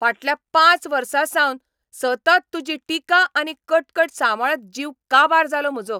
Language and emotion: Goan Konkani, angry